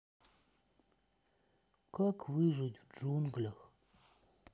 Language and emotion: Russian, sad